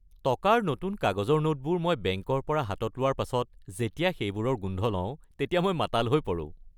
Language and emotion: Assamese, happy